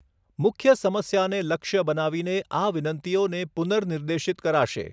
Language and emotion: Gujarati, neutral